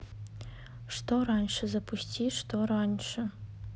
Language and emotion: Russian, neutral